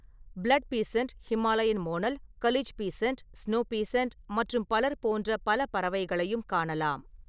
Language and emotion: Tamil, neutral